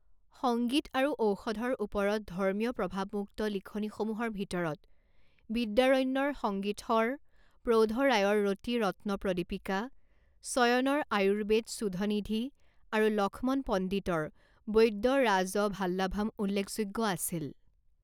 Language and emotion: Assamese, neutral